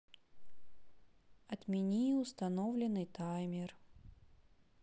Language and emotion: Russian, sad